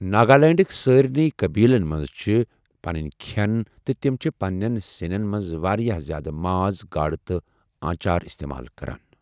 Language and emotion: Kashmiri, neutral